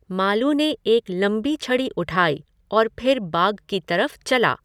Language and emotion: Hindi, neutral